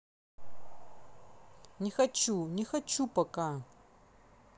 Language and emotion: Russian, angry